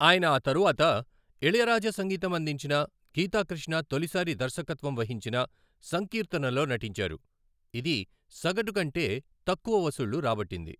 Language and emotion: Telugu, neutral